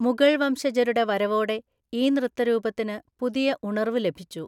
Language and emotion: Malayalam, neutral